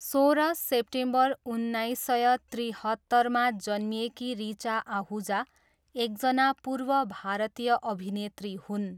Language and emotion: Nepali, neutral